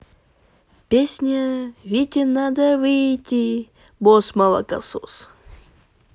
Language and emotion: Russian, positive